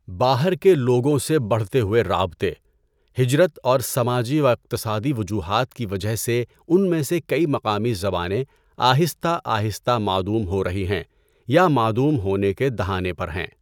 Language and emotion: Urdu, neutral